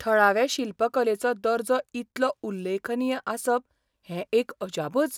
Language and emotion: Goan Konkani, surprised